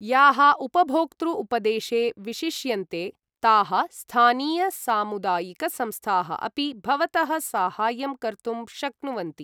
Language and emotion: Sanskrit, neutral